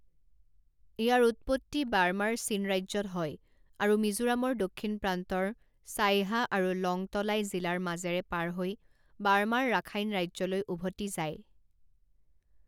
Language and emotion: Assamese, neutral